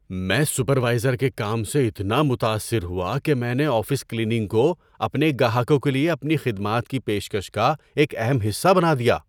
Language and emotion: Urdu, surprised